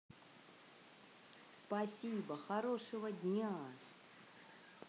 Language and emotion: Russian, positive